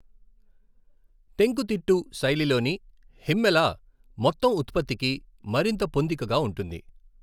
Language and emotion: Telugu, neutral